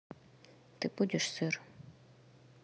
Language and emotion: Russian, neutral